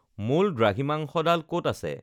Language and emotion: Assamese, neutral